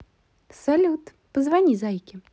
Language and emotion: Russian, positive